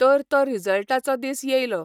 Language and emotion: Goan Konkani, neutral